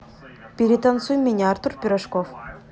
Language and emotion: Russian, neutral